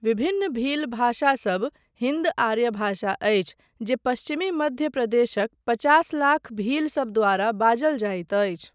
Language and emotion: Maithili, neutral